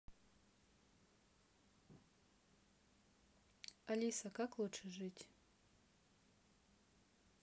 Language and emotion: Russian, neutral